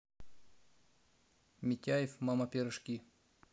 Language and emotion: Russian, neutral